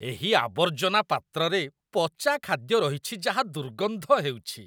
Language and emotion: Odia, disgusted